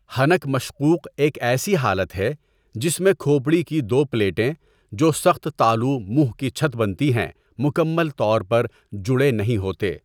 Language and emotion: Urdu, neutral